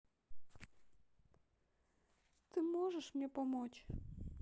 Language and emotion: Russian, sad